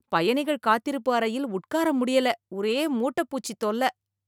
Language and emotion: Tamil, disgusted